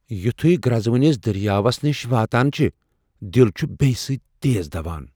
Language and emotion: Kashmiri, fearful